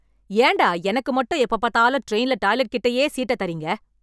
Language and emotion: Tamil, angry